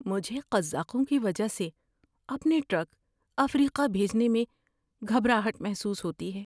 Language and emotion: Urdu, fearful